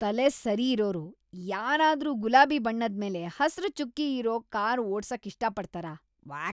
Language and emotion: Kannada, disgusted